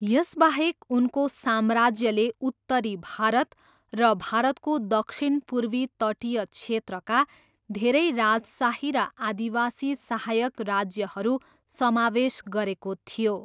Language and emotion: Nepali, neutral